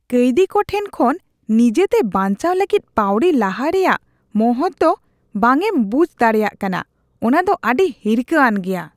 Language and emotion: Santali, disgusted